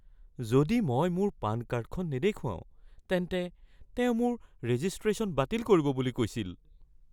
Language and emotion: Assamese, fearful